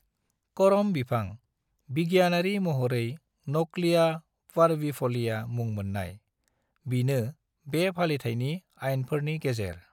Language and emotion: Bodo, neutral